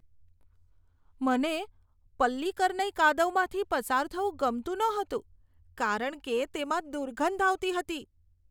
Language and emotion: Gujarati, disgusted